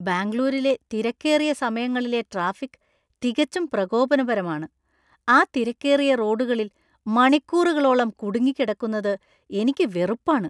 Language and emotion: Malayalam, disgusted